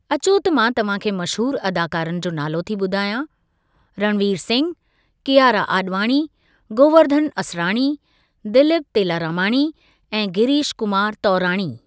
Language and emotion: Sindhi, neutral